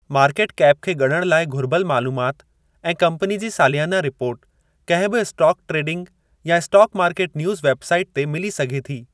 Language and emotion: Sindhi, neutral